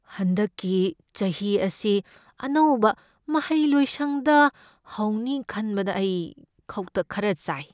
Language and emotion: Manipuri, fearful